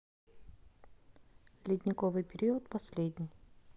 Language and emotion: Russian, neutral